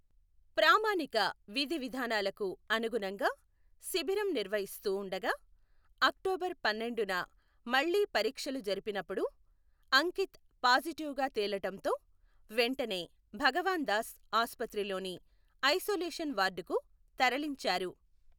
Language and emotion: Telugu, neutral